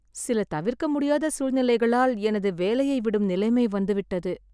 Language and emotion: Tamil, sad